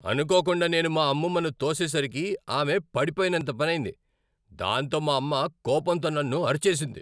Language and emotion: Telugu, angry